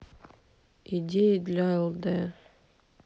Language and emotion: Russian, sad